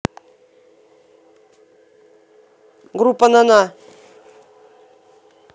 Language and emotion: Russian, angry